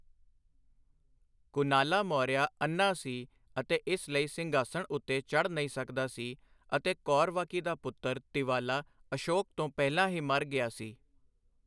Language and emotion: Punjabi, neutral